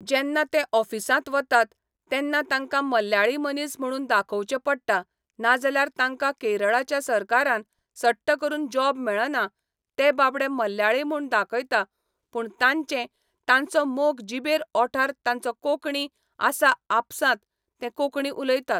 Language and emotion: Goan Konkani, neutral